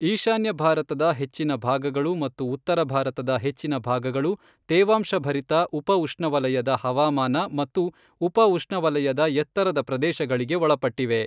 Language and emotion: Kannada, neutral